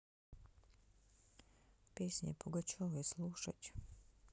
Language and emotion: Russian, neutral